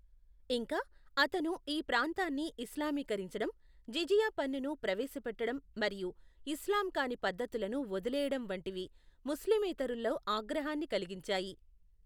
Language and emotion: Telugu, neutral